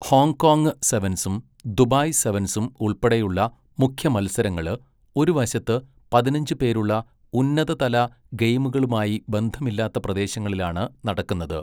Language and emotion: Malayalam, neutral